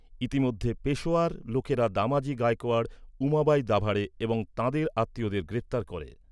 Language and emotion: Bengali, neutral